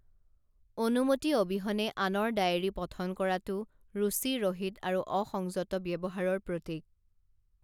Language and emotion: Assamese, neutral